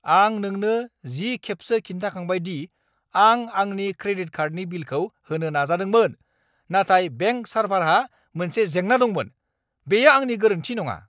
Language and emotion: Bodo, angry